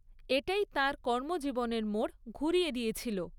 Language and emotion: Bengali, neutral